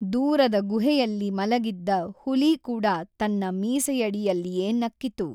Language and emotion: Kannada, neutral